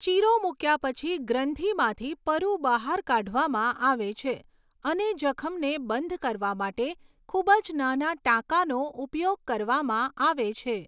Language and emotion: Gujarati, neutral